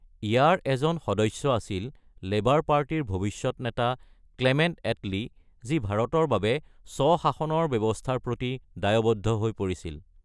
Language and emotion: Assamese, neutral